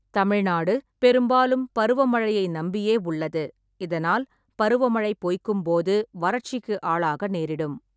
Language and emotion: Tamil, neutral